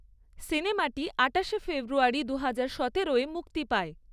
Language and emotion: Bengali, neutral